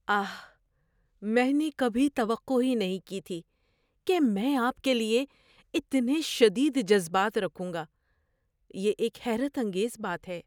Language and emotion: Urdu, surprised